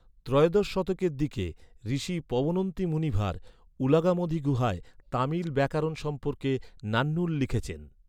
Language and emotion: Bengali, neutral